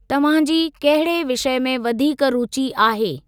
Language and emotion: Sindhi, neutral